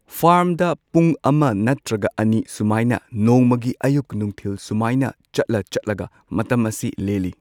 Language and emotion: Manipuri, neutral